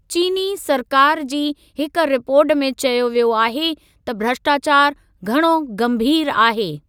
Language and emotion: Sindhi, neutral